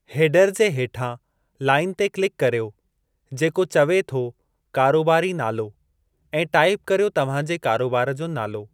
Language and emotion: Sindhi, neutral